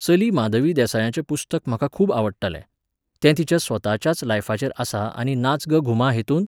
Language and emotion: Goan Konkani, neutral